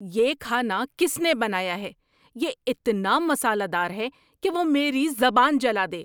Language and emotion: Urdu, angry